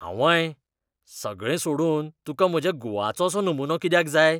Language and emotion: Goan Konkani, disgusted